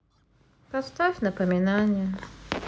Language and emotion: Russian, sad